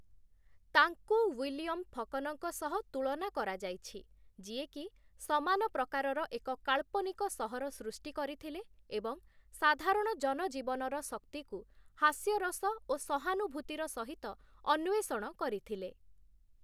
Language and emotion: Odia, neutral